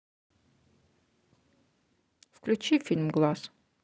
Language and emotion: Russian, neutral